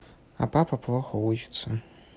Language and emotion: Russian, neutral